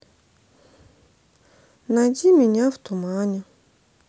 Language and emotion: Russian, sad